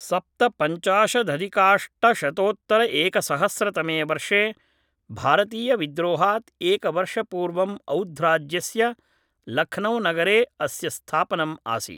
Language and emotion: Sanskrit, neutral